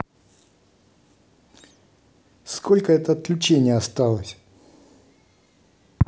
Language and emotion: Russian, neutral